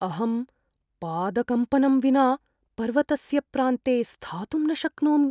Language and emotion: Sanskrit, fearful